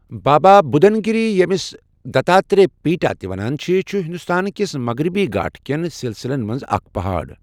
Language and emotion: Kashmiri, neutral